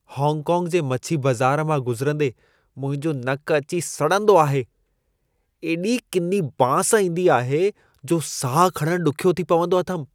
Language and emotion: Sindhi, disgusted